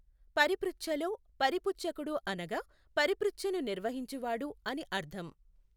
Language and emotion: Telugu, neutral